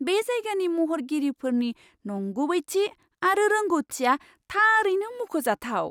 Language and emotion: Bodo, surprised